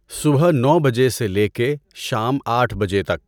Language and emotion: Urdu, neutral